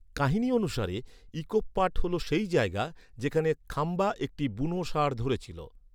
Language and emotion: Bengali, neutral